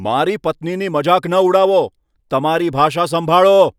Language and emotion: Gujarati, angry